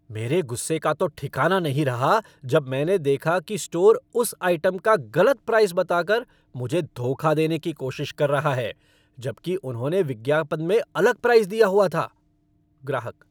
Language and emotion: Hindi, angry